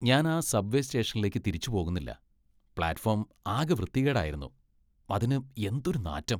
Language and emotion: Malayalam, disgusted